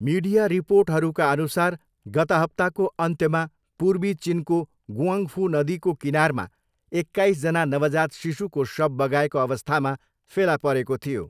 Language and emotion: Nepali, neutral